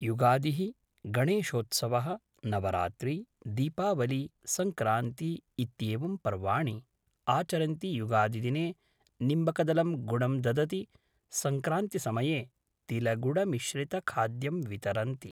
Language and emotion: Sanskrit, neutral